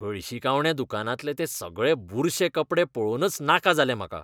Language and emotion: Goan Konkani, disgusted